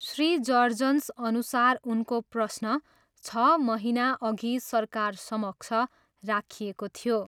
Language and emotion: Nepali, neutral